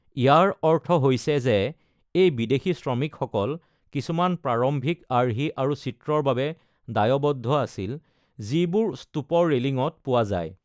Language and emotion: Assamese, neutral